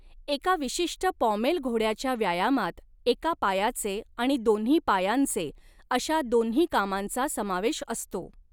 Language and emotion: Marathi, neutral